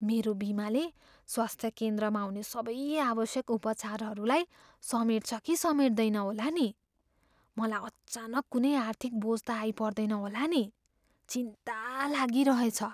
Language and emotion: Nepali, fearful